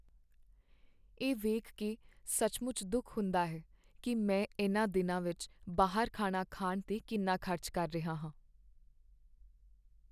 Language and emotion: Punjabi, sad